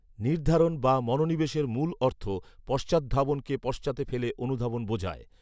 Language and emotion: Bengali, neutral